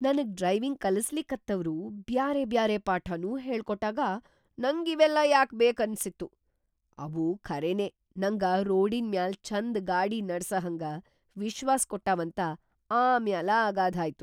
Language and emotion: Kannada, surprised